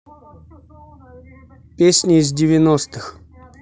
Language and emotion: Russian, neutral